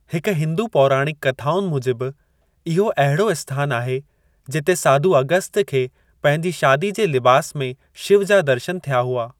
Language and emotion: Sindhi, neutral